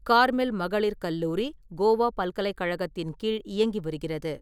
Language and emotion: Tamil, neutral